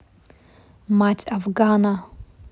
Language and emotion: Russian, neutral